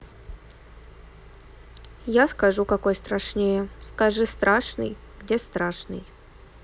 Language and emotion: Russian, neutral